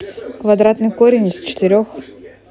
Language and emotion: Russian, neutral